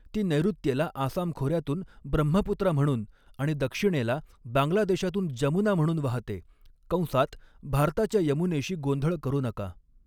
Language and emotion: Marathi, neutral